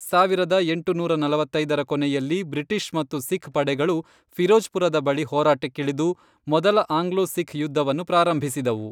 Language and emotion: Kannada, neutral